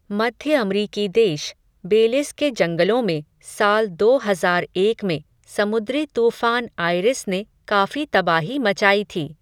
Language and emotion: Hindi, neutral